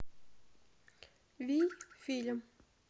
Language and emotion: Russian, neutral